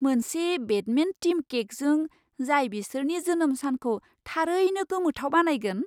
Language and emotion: Bodo, surprised